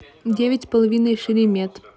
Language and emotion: Russian, neutral